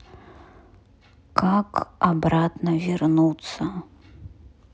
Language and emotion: Russian, sad